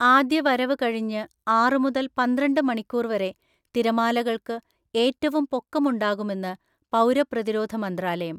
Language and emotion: Malayalam, neutral